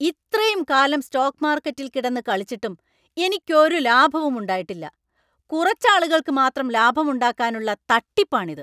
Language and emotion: Malayalam, angry